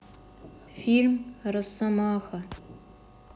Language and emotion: Russian, sad